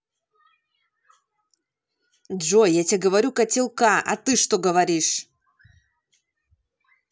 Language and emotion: Russian, angry